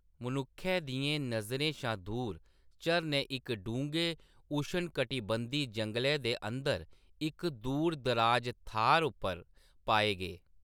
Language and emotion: Dogri, neutral